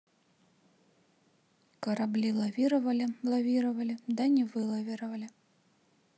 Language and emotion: Russian, neutral